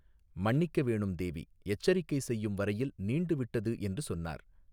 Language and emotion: Tamil, neutral